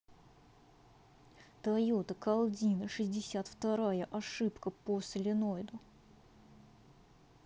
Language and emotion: Russian, angry